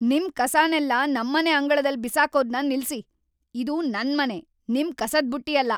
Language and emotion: Kannada, angry